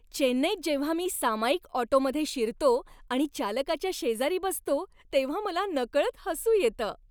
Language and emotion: Marathi, happy